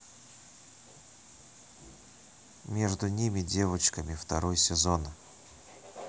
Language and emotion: Russian, neutral